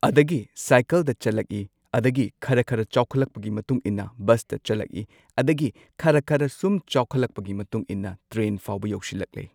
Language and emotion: Manipuri, neutral